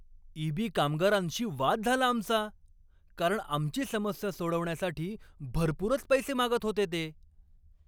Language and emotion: Marathi, angry